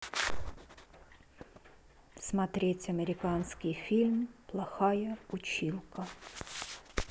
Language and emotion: Russian, neutral